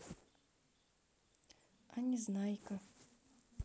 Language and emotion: Russian, sad